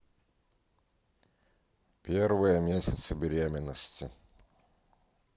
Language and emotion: Russian, neutral